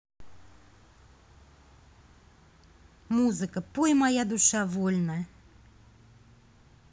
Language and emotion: Russian, neutral